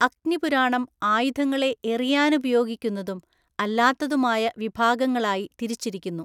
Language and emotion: Malayalam, neutral